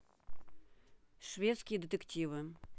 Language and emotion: Russian, neutral